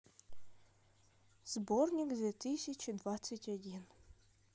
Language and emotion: Russian, neutral